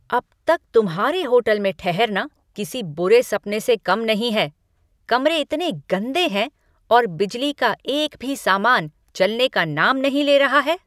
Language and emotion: Hindi, angry